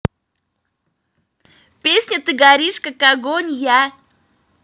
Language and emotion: Russian, positive